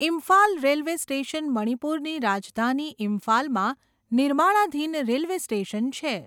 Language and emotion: Gujarati, neutral